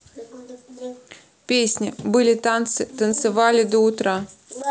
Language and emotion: Russian, neutral